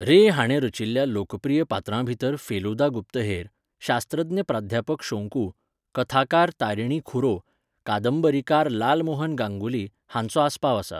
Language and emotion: Goan Konkani, neutral